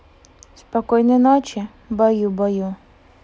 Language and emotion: Russian, neutral